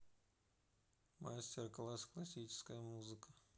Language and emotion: Russian, neutral